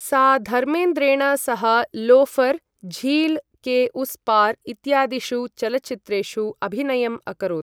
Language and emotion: Sanskrit, neutral